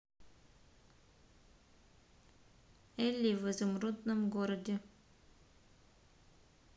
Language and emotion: Russian, neutral